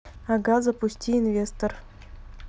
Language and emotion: Russian, neutral